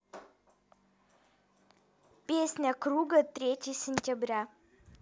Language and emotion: Russian, neutral